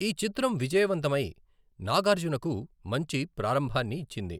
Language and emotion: Telugu, neutral